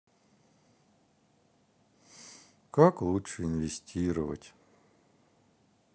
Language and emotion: Russian, sad